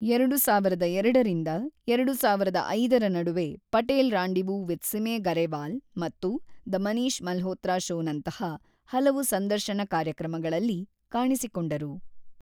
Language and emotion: Kannada, neutral